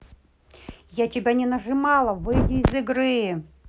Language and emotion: Russian, angry